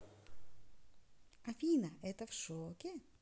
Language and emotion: Russian, positive